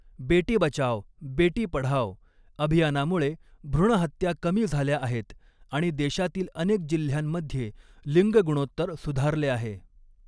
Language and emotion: Marathi, neutral